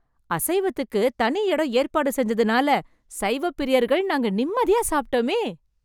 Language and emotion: Tamil, happy